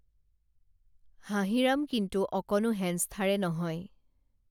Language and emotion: Assamese, neutral